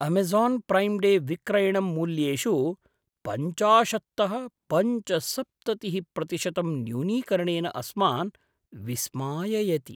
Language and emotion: Sanskrit, surprised